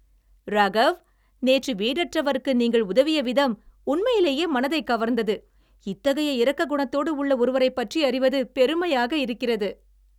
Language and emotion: Tamil, happy